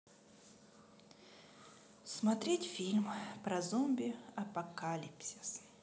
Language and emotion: Russian, sad